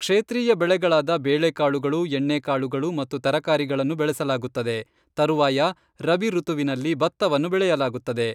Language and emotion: Kannada, neutral